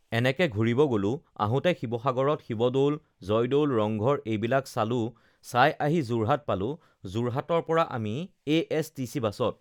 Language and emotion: Assamese, neutral